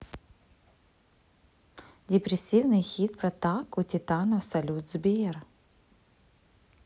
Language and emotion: Russian, neutral